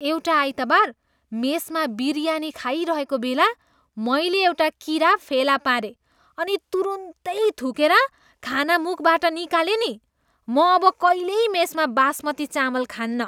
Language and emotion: Nepali, disgusted